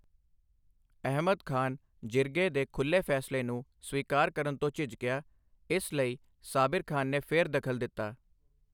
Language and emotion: Punjabi, neutral